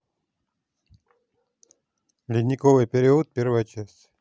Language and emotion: Russian, neutral